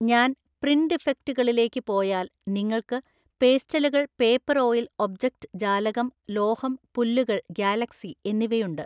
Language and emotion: Malayalam, neutral